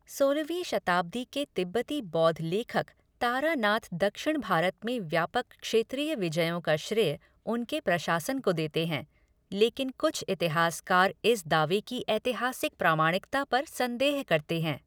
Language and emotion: Hindi, neutral